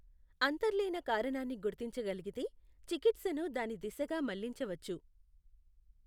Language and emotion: Telugu, neutral